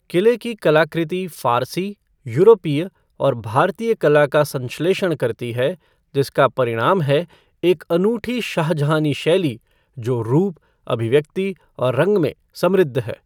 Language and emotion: Hindi, neutral